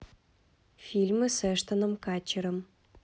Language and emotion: Russian, neutral